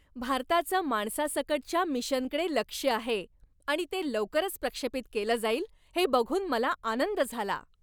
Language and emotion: Marathi, happy